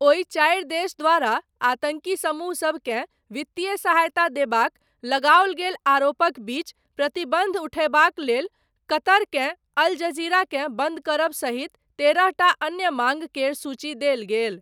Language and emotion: Maithili, neutral